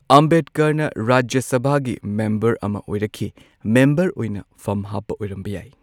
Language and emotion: Manipuri, neutral